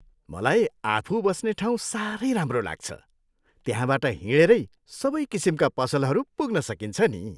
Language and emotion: Nepali, happy